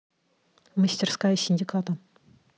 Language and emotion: Russian, neutral